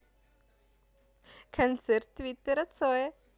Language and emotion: Russian, positive